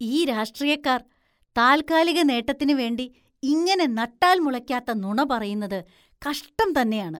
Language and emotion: Malayalam, disgusted